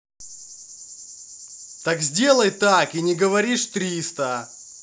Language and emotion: Russian, angry